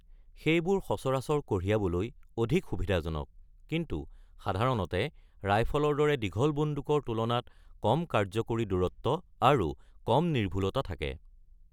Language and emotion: Assamese, neutral